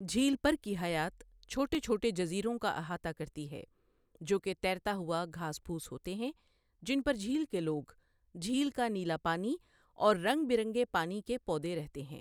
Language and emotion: Urdu, neutral